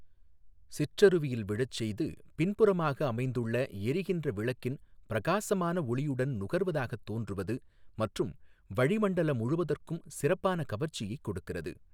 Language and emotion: Tamil, neutral